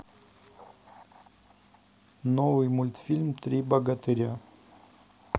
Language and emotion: Russian, neutral